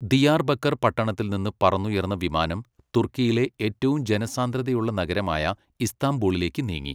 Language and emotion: Malayalam, neutral